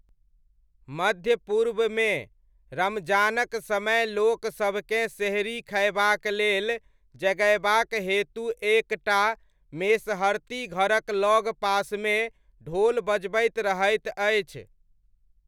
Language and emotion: Maithili, neutral